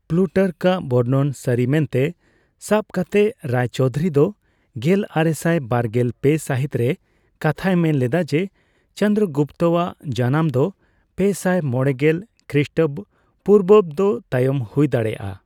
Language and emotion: Santali, neutral